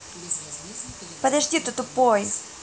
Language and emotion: Russian, angry